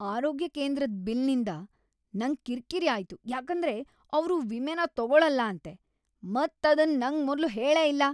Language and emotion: Kannada, angry